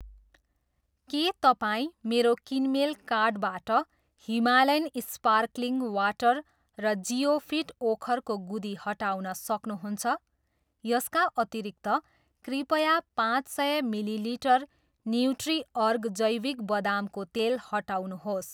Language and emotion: Nepali, neutral